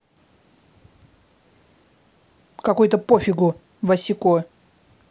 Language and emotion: Russian, angry